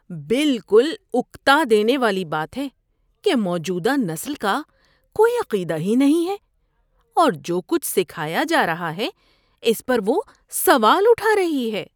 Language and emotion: Urdu, disgusted